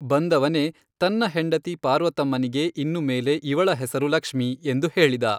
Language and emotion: Kannada, neutral